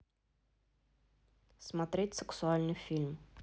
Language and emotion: Russian, neutral